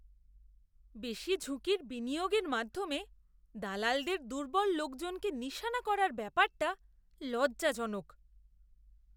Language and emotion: Bengali, disgusted